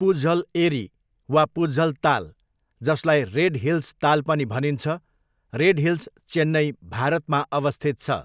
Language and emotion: Nepali, neutral